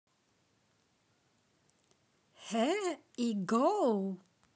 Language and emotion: Russian, positive